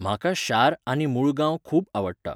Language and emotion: Goan Konkani, neutral